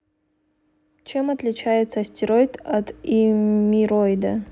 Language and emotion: Russian, neutral